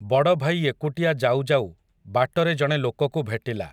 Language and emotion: Odia, neutral